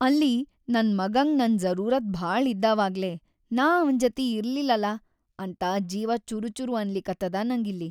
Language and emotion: Kannada, sad